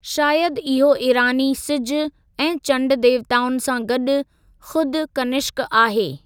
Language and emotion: Sindhi, neutral